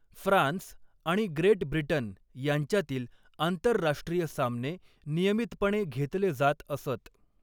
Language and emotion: Marathi, neutral